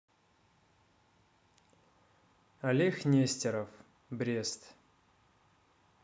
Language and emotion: Russian, neutral